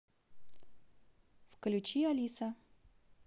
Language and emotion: Russian, neutral